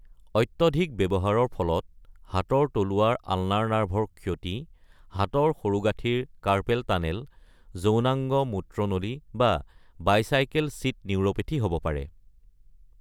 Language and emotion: Assamese, neutral